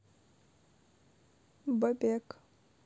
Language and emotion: Russian, neutral